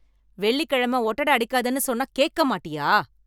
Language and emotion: Tamil, angry